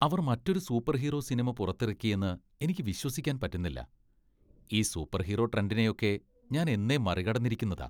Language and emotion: Malayalam, disgusted